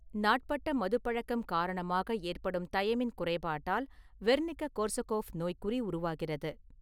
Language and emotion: Tamil, neutral